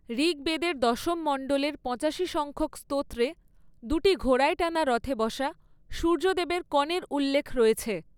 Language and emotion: Bengali, neutral